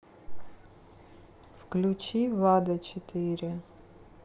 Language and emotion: Russian, neutral